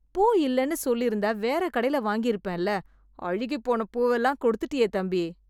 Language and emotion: Tamil, disgusted